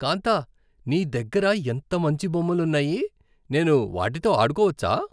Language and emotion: Telugu, happy